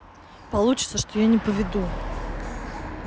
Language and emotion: Russian, neutral